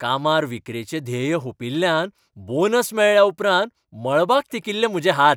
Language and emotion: Goan Konkani, happy